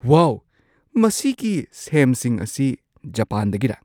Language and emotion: Manipuri, surprised